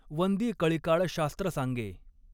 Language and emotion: Marathi, neutral